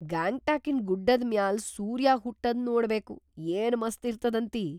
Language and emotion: Kannada, surprised